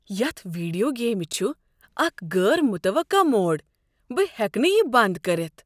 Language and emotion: Kashmiri, surprised